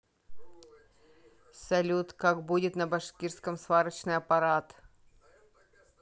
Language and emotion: Russian, neutral